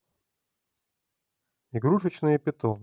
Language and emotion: Russian, neutral